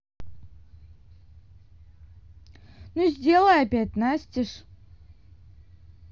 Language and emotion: Russian, neutral